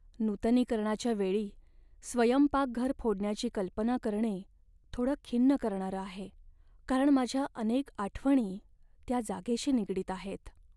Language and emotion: Marathi, sad